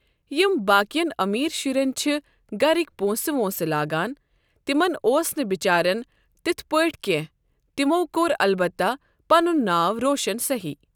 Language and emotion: Kashmiri, neutral